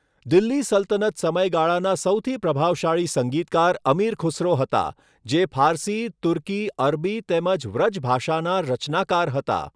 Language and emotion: Gujarati, neutral